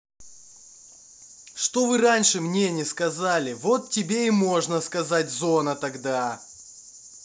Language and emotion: Russian, angry